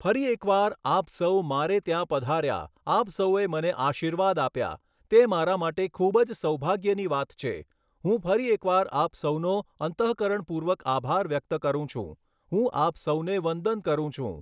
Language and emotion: Gujarati, neutral